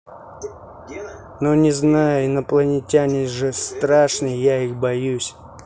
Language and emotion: Russian, neutral